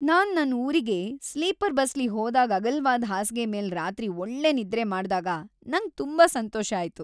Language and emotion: Kannada, happy